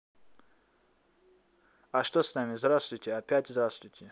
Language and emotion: Russian, neutral